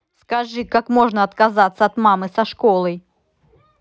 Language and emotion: Russian, angry